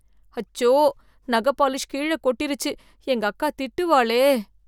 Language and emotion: Tamil, fearful